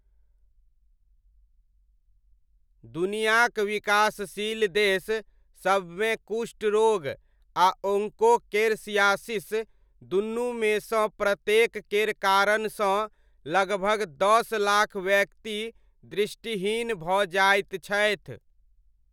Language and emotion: Maithili, neutral